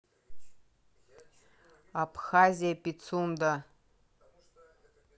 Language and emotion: Russian, neutral